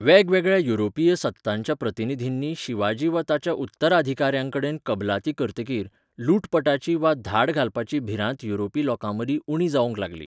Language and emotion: Goan Konkani, neutral